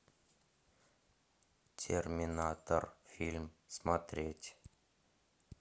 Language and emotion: Russian, neutral